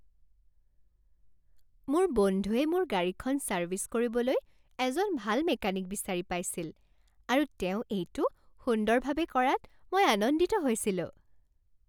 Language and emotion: Assamese, happy